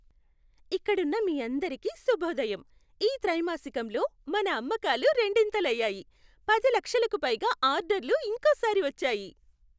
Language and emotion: Telugu, happy